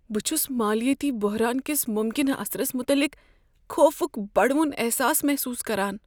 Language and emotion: Kashmiri, fearful